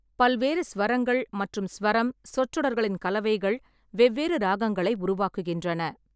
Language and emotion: Tamil, neutral